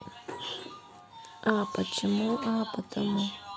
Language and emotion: Russian, neutral